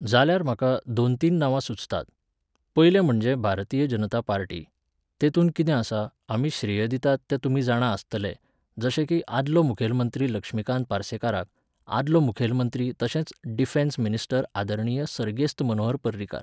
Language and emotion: Goan Konkani, neutral